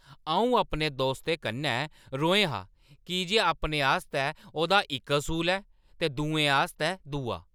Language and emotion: Dogri, angry